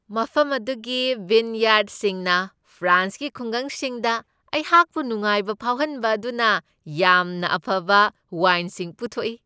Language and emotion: Manipuri, happy